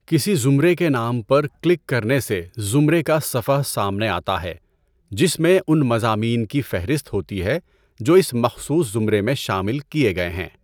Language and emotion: Urdu, neutral